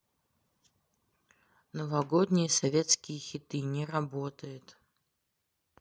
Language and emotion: Russian, neutral